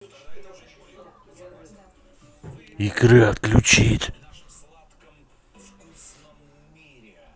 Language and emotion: Russian, angry